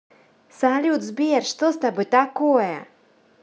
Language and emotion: Russian, positive